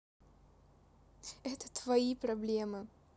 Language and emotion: Russian, neutral